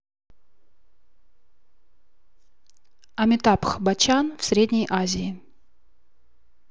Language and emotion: Russian, neutral